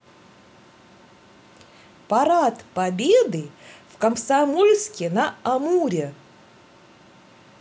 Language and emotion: Russian, positive